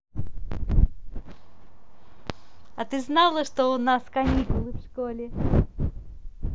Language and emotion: Russian, positive